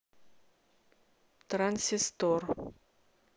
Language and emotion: Russian, neutral